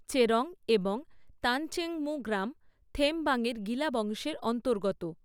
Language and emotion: Bengali, neutral